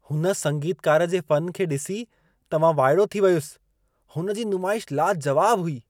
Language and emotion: Sindhi, surprised